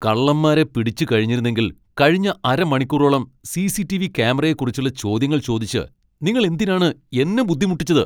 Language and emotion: Malayalam, angry